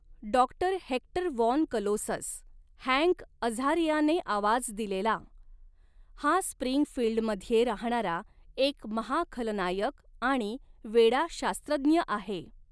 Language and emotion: Marathi, neutral